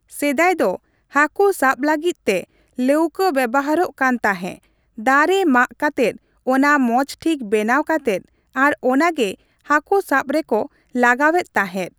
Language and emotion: Santali, neutral